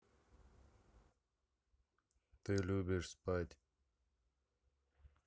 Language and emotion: Russian, neutral